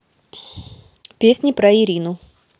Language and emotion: Russian, neutral